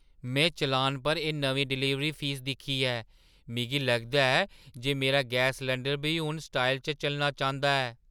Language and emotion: Dogri, surprised